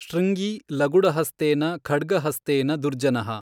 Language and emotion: Kannada, neutral